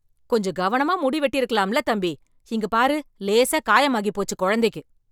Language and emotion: Tamil, angry